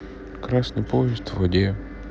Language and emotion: Russian, sad